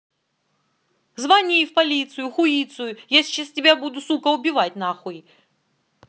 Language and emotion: Russian, angry